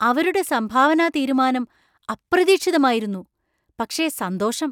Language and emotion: Malayalam, surprised